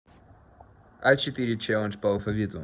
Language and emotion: Russian, neutral